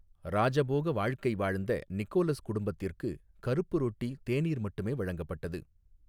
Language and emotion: Tamil, neutral